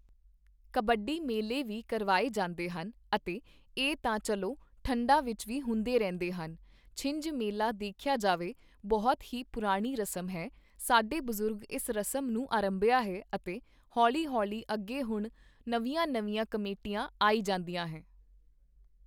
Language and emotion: Punjabi, neutral